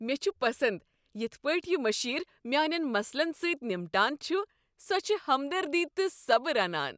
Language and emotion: Kashmiri, happy